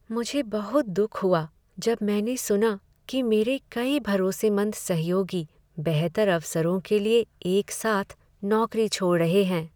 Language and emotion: Hindi, sad